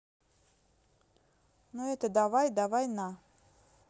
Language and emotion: Russian, neutral